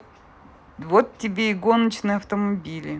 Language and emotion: Russian, neutral